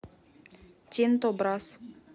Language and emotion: Russian, neutral